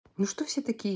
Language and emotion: Russian, angry